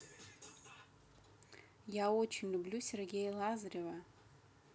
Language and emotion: Russian, neutral